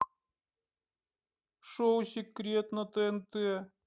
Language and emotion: Russian, sad